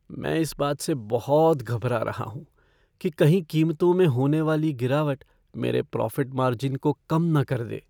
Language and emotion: Hindi, fearful